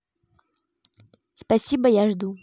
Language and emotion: Russian, neutral